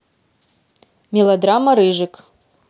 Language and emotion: Russian, neutral